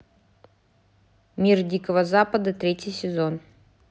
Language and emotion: Russian, neutral